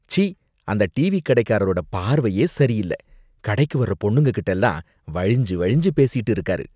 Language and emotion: Tamil, disgusted